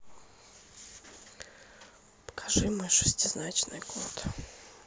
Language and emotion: Russian, sad